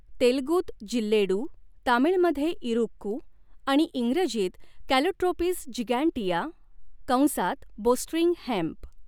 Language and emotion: Marathi, neutral